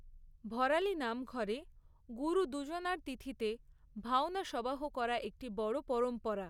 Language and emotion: Bengali, neutral